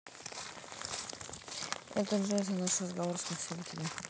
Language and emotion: Russian, neutral